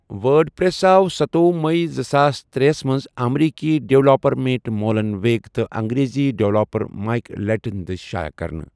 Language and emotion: Kashmiri, neutral